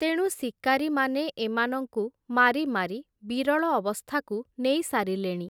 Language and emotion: Odia, neutral